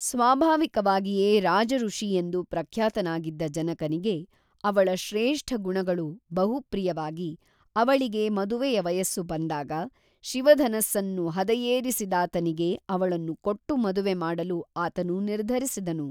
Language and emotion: Kannada, neutral